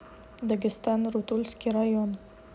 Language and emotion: Russian, neutral